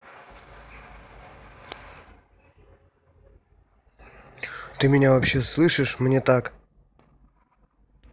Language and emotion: Russian, angry